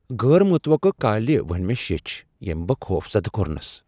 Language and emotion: Kashmiri, fearful